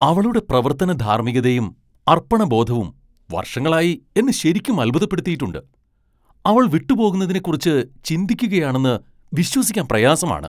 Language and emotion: Malayalam, surprised